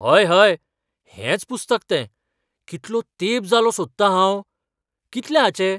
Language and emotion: Goan Konkani, surprised